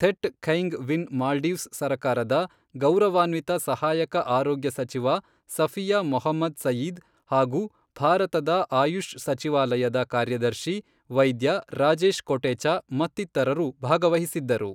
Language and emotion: Kannada, neutral